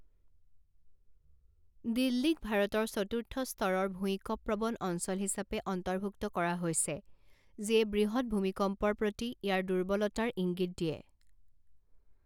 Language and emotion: Assamese, neutral